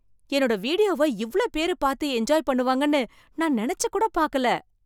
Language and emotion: Tamil, surprised